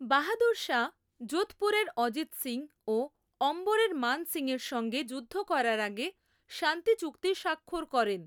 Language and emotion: Bengali, neutral